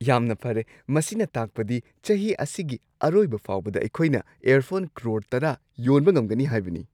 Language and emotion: Manipuri, surprised